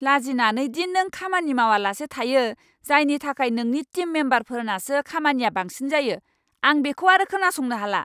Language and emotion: Bodo, angry